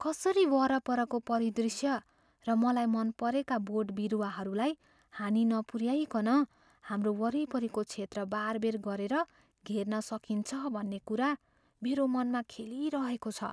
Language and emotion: Nepali, fearful